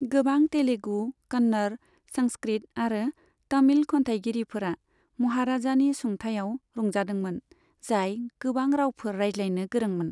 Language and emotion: Bodo, neutral